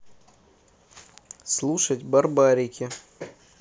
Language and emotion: Russian, neutral